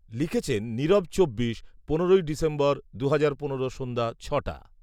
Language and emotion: Bengali, neutral